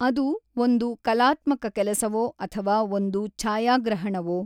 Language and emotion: Kannada, neutral